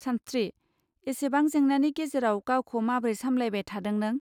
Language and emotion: Bodo, neutral